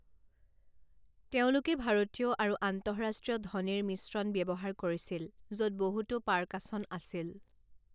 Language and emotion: Assamese, neutral